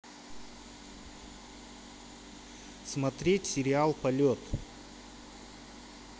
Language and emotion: Russian, neutral